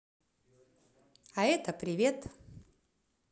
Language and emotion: Russian, positive